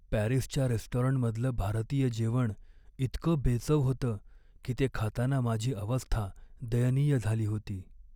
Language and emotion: Marathi, sad